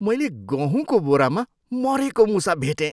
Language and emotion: Nepali, disgusted